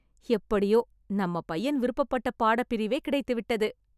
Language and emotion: Tamil, happy